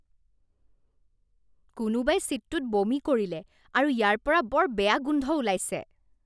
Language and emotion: Assamese, disgusted